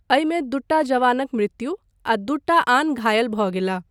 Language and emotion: Maithili, neutral